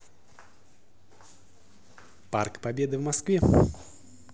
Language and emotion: Russian, positive